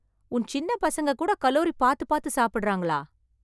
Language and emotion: Tamil, surprised